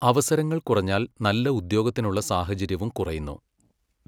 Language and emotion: Malayalam, neutral